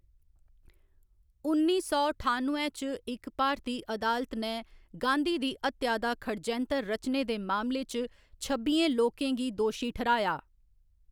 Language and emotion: Dogri, neutral